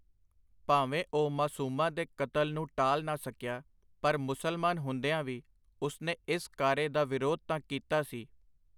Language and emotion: Punjabi, neutral